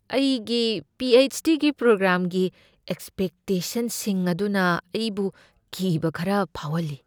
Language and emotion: Manipuri, fearful